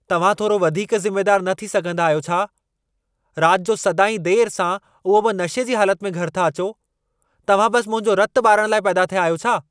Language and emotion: Sindhi, angry